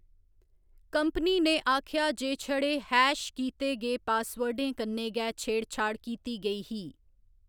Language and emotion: Dogri, neutral